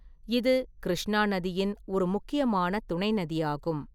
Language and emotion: Tamil, neutral